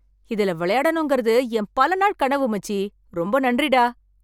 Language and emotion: Tamil, happy